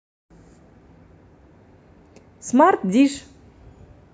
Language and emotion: Russian, positive